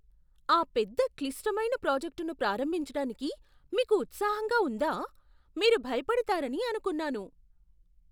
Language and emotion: Telugu, surprised